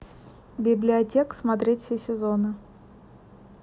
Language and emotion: Russian, neutral